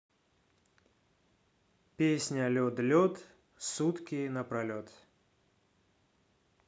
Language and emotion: Russian, neutral